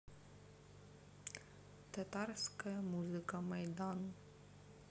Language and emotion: Russian, neutral